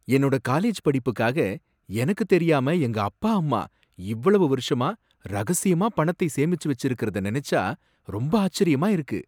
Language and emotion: Tamil, surprised